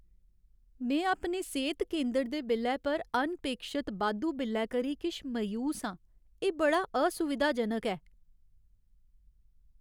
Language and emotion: Dogri, sad